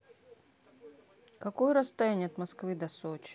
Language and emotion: Russian, neutral